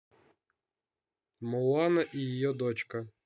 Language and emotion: Russian, neutral